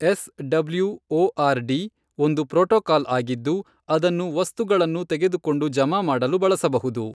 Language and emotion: Kannada, neutral